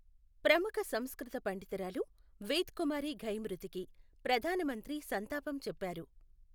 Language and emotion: Telugu, neutral